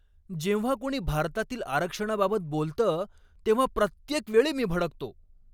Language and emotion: Marathi, angry